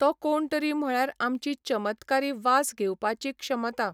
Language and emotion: Goan Konkani, neutral